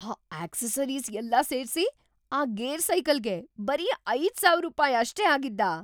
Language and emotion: Kannada, surprised